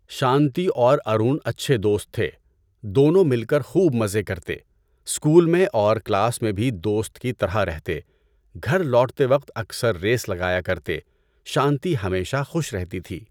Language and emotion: Urdu, neutral